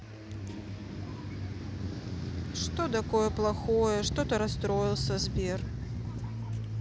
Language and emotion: Russian, sad